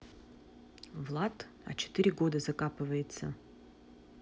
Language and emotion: Russian, neutral